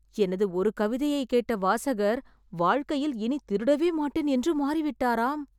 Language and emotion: Tamil, surprised